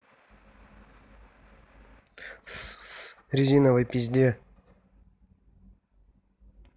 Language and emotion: Russian, neutral